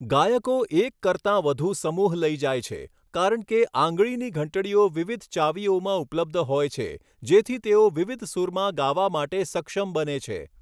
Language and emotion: Gujarati, neutral